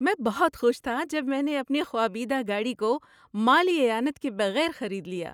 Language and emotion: Urdu, happy